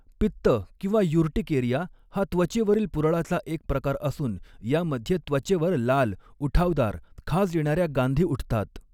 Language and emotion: Marathi, neutral